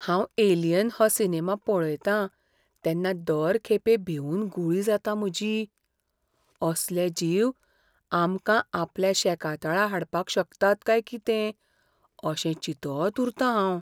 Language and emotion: Goan Konkani, fearful